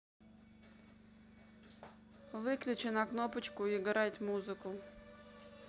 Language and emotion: Russian, neutral